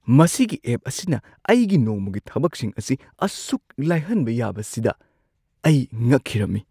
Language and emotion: Manipuri, surprised